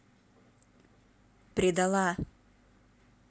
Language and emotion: Russian, angry